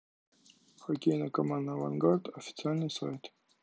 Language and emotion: Russian, neutral